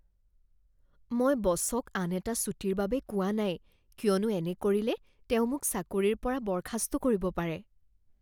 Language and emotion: Assamese, fearful